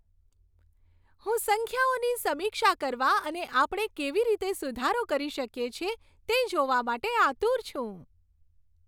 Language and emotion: Gujarati, happy